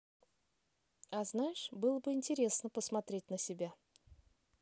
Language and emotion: Russian, neutral